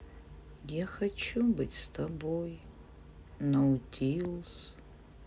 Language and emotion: Russian, sad